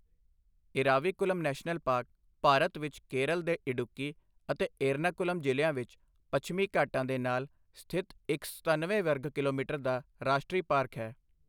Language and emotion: Punjabi, neutral